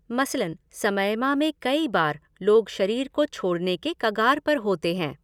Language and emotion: Hindi, neutral